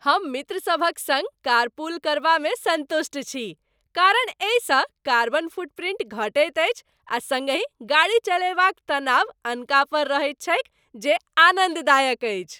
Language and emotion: Maithili, happy